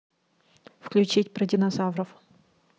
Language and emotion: Russian, neutral